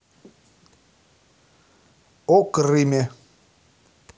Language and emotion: Russian, neutral